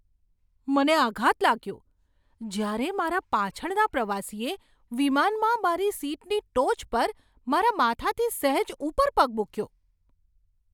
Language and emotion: Gujarati, surprised